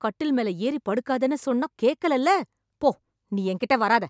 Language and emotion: Tamil, angry